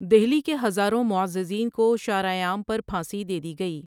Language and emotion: Urdu, neutral